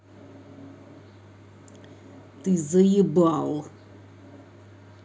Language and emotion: Russian, angry